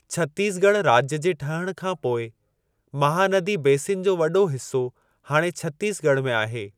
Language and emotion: Sindhi, neutral